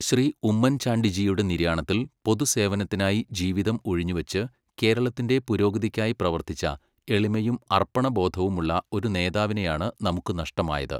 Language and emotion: Malayalam, neutral